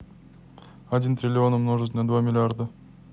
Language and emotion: Russian, neutral